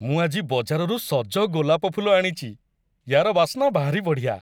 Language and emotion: Odia, happy